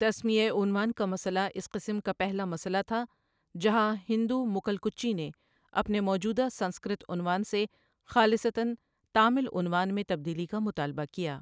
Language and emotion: Urdu, neutral